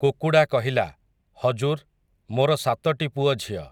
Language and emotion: Odia, neutral